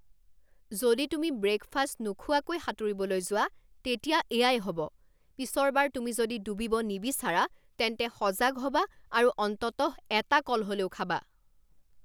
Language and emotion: Assamese, angry